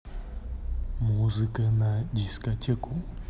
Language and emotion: Russian, neutral